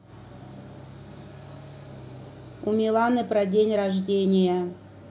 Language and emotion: Russian, neutral